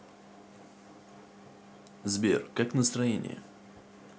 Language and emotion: Russian, neutral